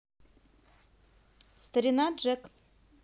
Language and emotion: Russian, neutral